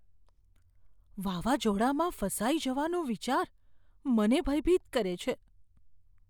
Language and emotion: Gujarati, fearful